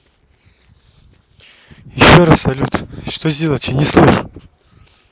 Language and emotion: Russian, neutral